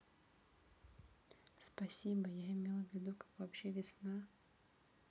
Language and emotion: Russian, neutral